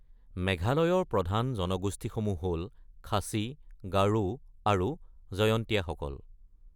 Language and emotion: Assamese, neutral